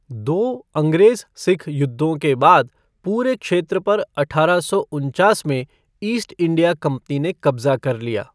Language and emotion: Hindi, neutral